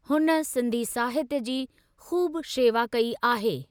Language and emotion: Sindhi, neutral